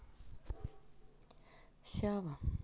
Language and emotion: Russian, sad